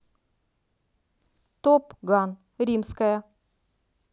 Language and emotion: Russian, neutral